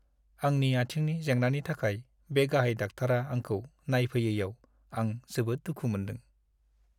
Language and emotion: Bodo, sad